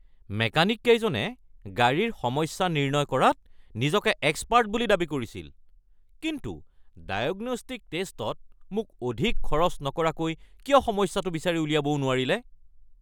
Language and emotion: Assamese, angry